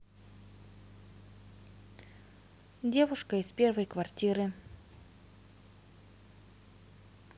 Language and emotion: Russian, neutral